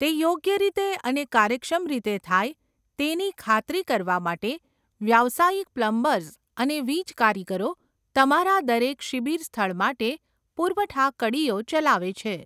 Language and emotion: Gujarati, neutral